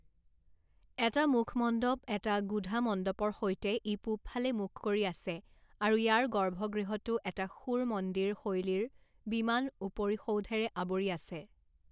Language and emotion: Assamese, neutral